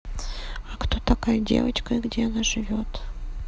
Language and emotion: Russian, neutral